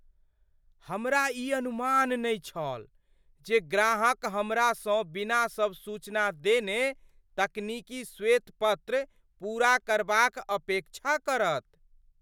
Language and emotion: Maithili, surprised